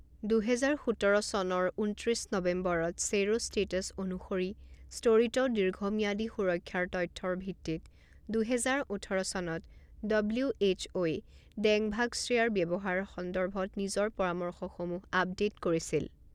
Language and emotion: Assamese, neutral